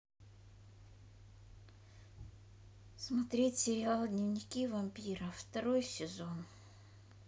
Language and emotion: Russian, sad